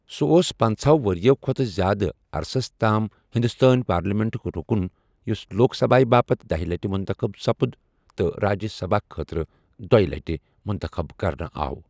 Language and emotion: Kashmiri, neutral